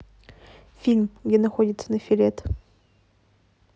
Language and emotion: Russian, neutral